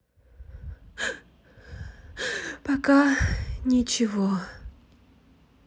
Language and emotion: Russian, sad